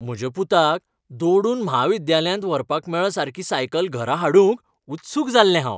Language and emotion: Goan Konkani, happy